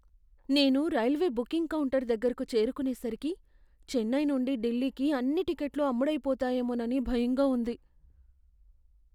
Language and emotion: Telugu, fearful